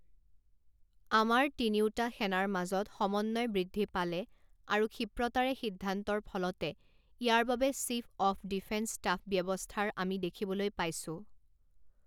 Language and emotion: Assamese, neutral